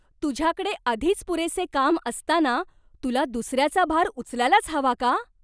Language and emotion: Marathi, surprised